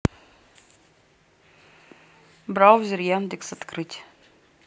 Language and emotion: Russian, neutral